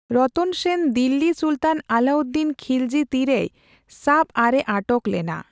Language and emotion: Santali, neutral